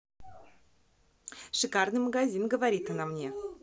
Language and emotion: Russian, positive